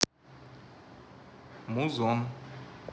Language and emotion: Russian, neutral